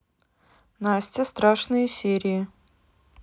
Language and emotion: Russian, neutral